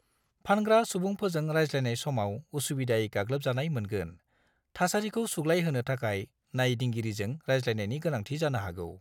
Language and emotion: Bodo, neutral